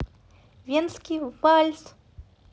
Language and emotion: Russian, positive